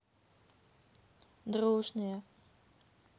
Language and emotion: Russian, sad